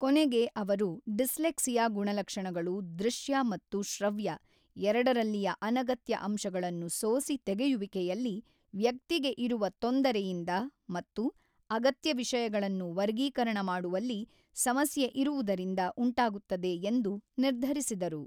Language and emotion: Kannada, neutral